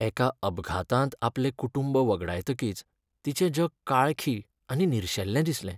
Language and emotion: Goan Konkani, sad